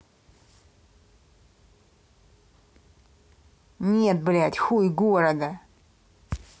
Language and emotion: Russian, angry